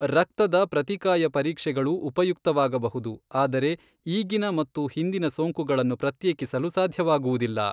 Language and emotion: Kannada, neutral